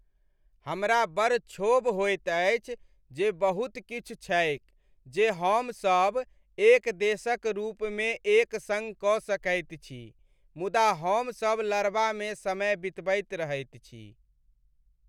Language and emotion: Maithili, sad